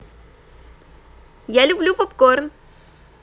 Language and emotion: Russian, positive